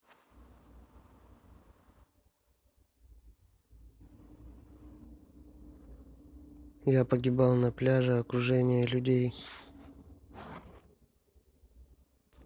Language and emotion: Russian, neutral